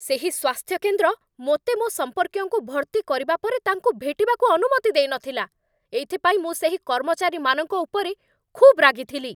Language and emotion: Odia, angry